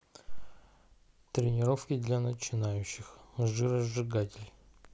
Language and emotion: Russian, neutral